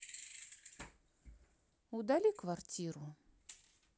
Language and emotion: Russian, neutral